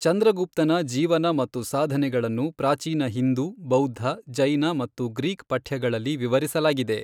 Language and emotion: Kannada, neutral